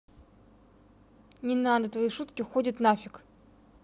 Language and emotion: Russian, angry